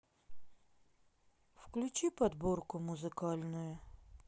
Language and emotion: Russian, sad